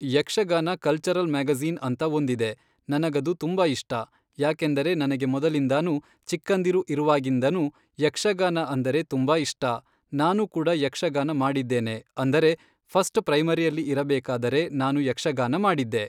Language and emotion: Kannada, neutral